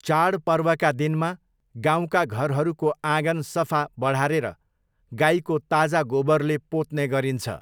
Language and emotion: Nepali, neutral